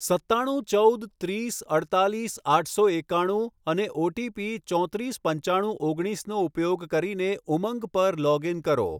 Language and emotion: Gujarati, neutral